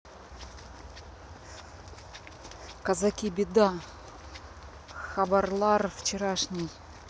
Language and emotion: Russian, neutral